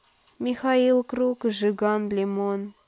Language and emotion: Russian, neutral